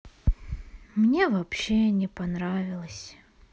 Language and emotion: Russian, sad